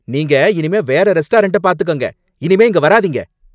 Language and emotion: Tamil, angry